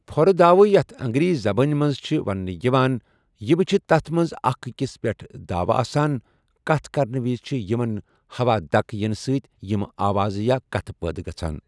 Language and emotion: Kashmiri, neutral